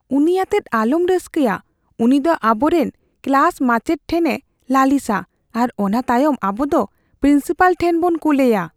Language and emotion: Santali, fearful